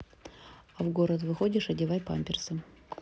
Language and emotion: Russian, neutral